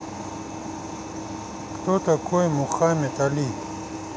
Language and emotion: Russian, neutral